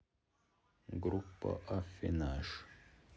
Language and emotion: Russian, neutral